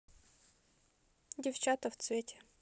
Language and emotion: Russian, neutral